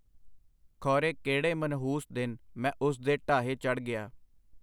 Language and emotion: Punjabi, neutral